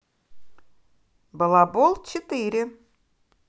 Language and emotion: Russian, positive